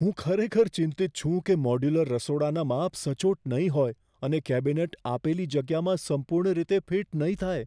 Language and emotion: Gujarati, fearful